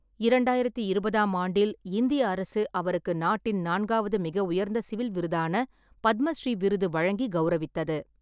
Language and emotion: Tamil, neutral